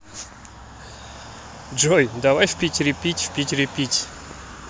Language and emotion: Russian, positive